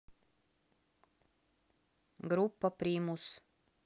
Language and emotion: Russian, neutral